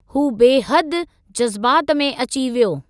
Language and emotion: Sindhi, neutral